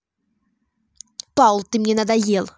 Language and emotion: Russian, angry